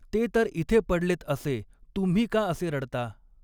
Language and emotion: Marathi, neutral